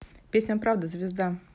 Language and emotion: Russian, neutral